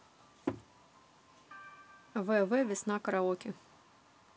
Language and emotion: Russian, neutral